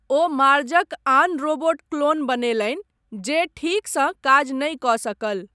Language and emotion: Maithili, neutral